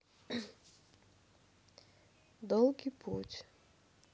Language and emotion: Russian, sad